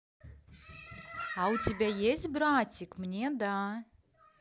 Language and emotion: Russian, positive